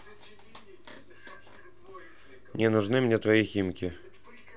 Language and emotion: Russian, neutral